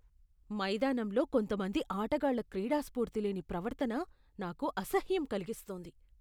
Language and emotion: Telugu, disgusted